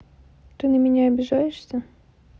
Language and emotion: Russian, neutral